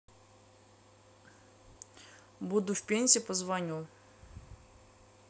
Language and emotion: Russian, neutral